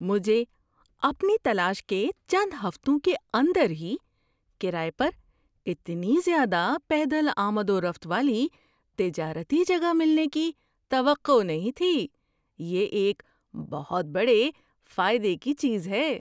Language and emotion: Urdu, surprised